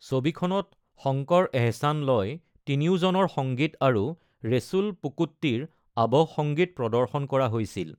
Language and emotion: Assamese, neutral